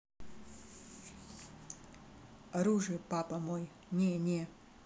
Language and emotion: Russian, neutral